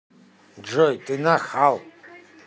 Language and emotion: Russian, angry